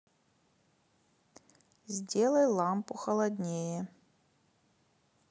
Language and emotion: Russian, neutral